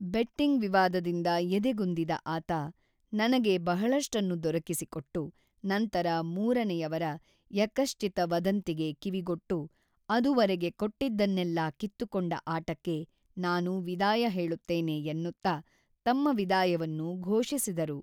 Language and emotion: Kannada, neutral